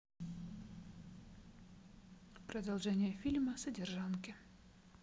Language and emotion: Russian, neutral